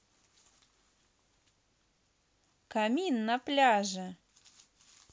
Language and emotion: Russian, positive